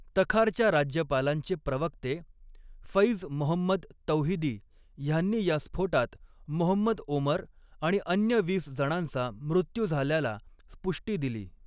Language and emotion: Marathi, neutral